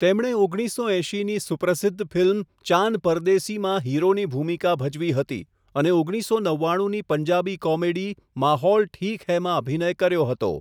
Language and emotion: Gujarati, neutral